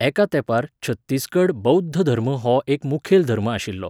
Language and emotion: Goan Konkani, neutral